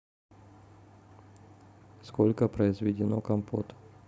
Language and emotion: Russian, neutral